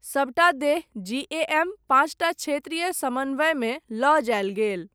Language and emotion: Maithili, neutral